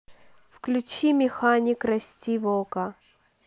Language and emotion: Russian, neutral